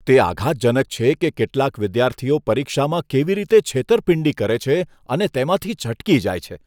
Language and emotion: Gujarati, disgusted